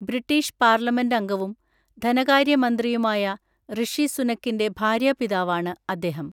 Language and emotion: Malayalam, neutral